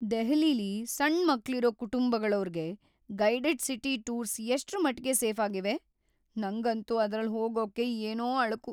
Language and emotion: Kannada, fearful